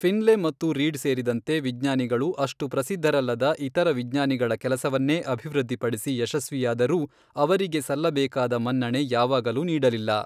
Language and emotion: Kannada, neutral